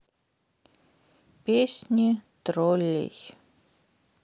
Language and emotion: Russian, sad